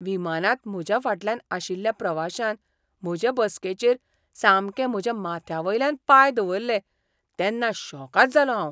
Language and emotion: Goan Konkani, surprised